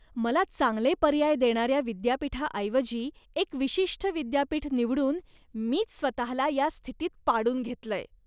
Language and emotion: Marathi, disgusted